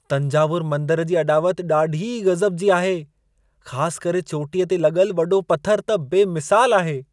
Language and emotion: Sindhi, surprised